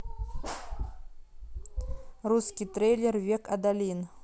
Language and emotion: Russian, neutral